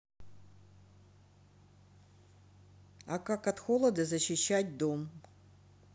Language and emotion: Russian, neutral